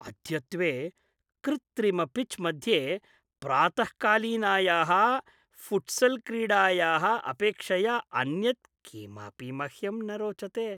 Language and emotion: Sanskrit, happy